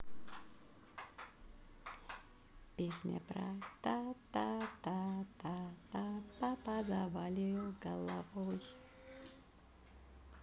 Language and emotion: Russian, positive